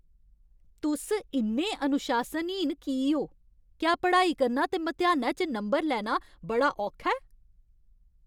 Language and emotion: Dogri, angry